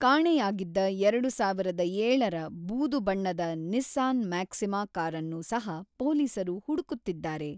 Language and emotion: Kannada, neutral